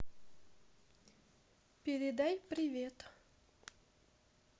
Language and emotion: Russian, neutral